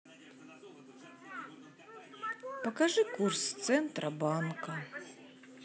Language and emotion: Russian, sad